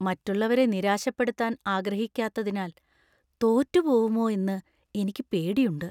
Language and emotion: Malayalam, fearful